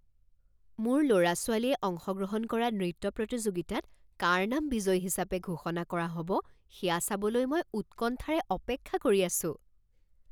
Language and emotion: Assamese, surprised